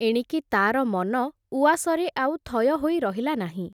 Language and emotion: Odia, neutral